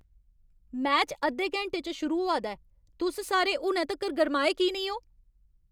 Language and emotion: Dogri, angry